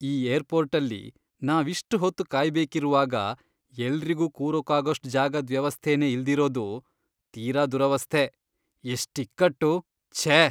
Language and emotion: Kannada, disgusted